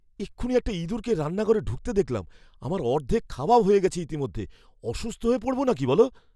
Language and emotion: Bengali, fearful